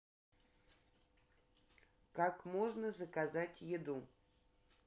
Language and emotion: Russian, neutral